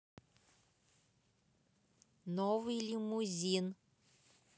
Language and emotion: Russian, neutral